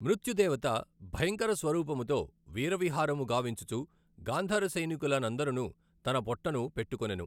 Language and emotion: Telugu, neutral